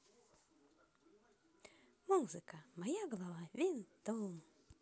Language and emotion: Russian, positive